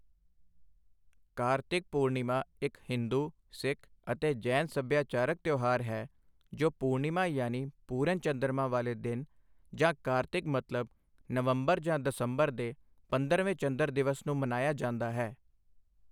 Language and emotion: Punjabi, neutral